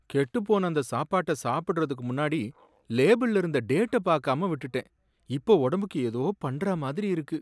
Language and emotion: Tamil, sad